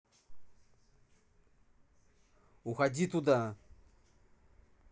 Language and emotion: Russian, angry